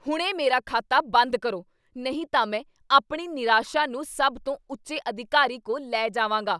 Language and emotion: Punjabi, angry